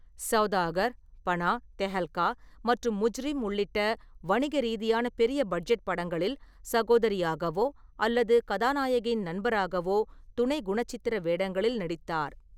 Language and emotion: Tamil, neutral